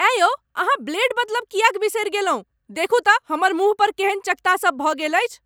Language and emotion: Maithili, angry